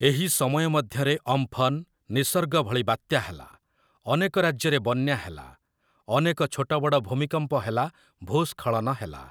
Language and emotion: Odia, neutral